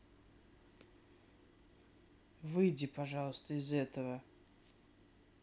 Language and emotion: Russian, neutral